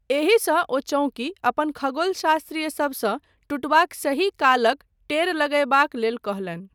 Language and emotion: Maithili, neutral